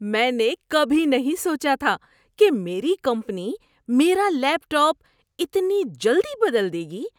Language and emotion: Urdu, surprised